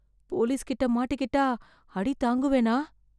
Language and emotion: Tamil, fearful